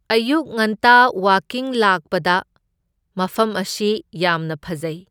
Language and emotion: Manipuri, neutral